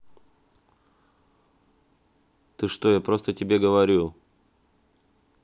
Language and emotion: Russian, angry